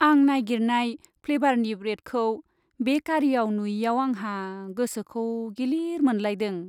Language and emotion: Bodo, sad